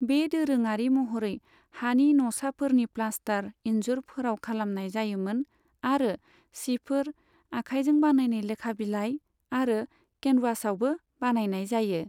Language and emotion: Bodo, neutral